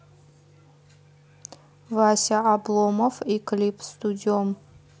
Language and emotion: Russian, neutral